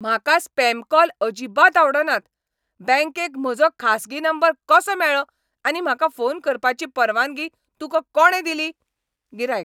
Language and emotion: Goan Konkani, angry